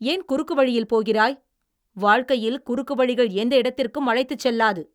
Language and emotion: Tamil, angry